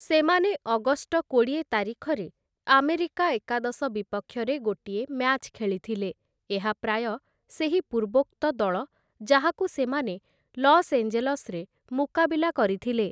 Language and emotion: Odia, neutral